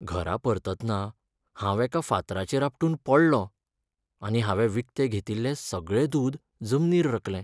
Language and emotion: Goan Konkani, sad